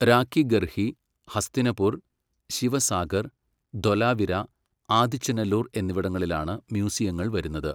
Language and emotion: Malayalam, neutral